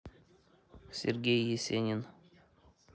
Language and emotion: Russian, neutral